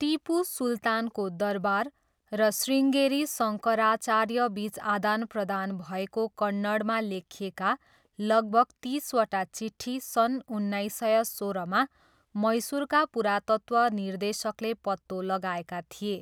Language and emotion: Nepali, neutral